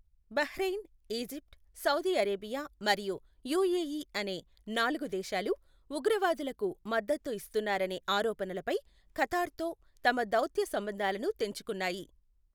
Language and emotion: Telugu, neutral